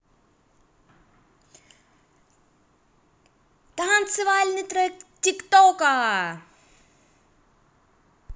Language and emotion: Russian, positive